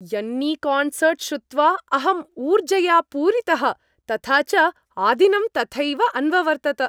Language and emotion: Sanskrit, happy